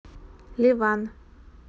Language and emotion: Russian, neutral